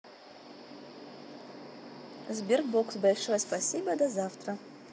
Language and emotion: Russian, positive